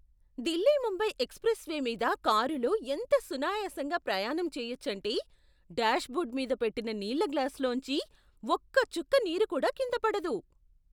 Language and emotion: Telugu, surprised